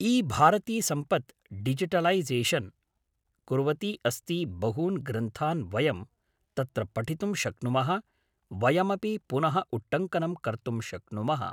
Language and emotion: Sanskrit, neutral